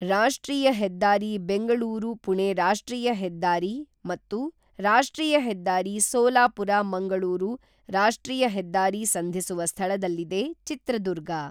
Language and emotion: Kannada, neutral